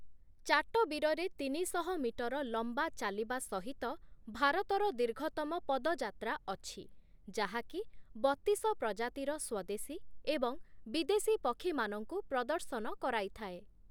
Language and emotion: Odia, neutral